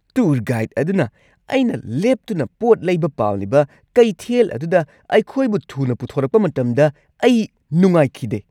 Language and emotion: Manipuri, angry